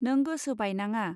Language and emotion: Bodo, neutral